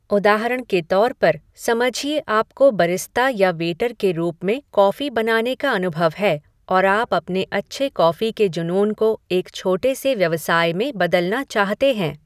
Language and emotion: Hindi, neutral